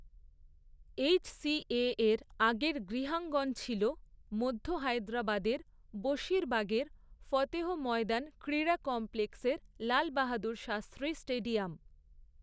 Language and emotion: Bengali, neutral